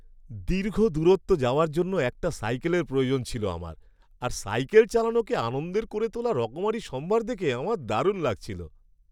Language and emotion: Bengali, happy